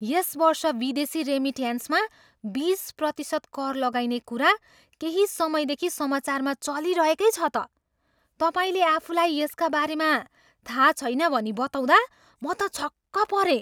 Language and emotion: Nepali, surprised